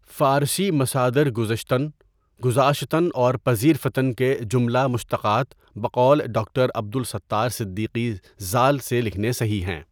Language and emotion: Urdu, neutral